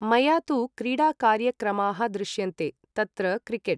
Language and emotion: Sanskrit, neutral